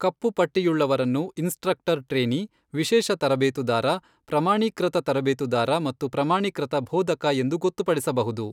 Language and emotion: Kannada, neutral